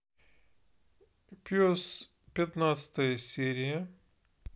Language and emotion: Russian, neutral